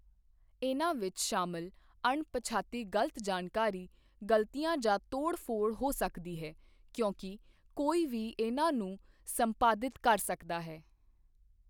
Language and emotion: Punjabi, neutral